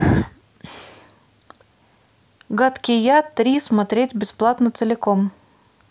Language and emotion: Russian, neutral